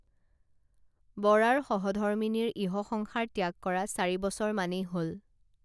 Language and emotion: Assamese, neutral